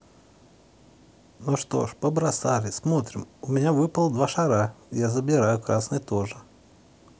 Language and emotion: Russian, neutral